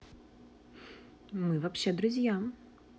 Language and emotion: Russian, neutral